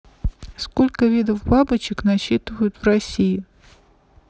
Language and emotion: Russian, neutral